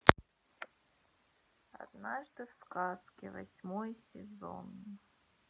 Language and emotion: Russian, sad